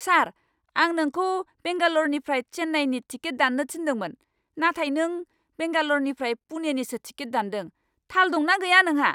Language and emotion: Bodo, angry